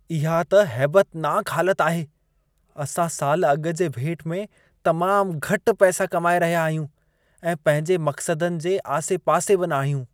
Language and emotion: Sindhi, disgusted